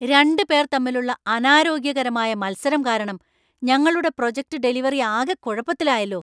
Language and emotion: Malayalam, angry